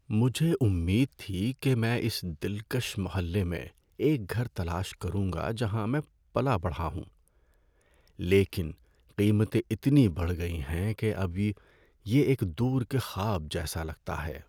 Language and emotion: Urdu, sad